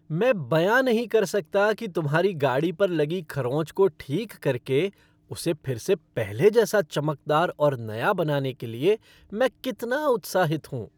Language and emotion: Hindi, happy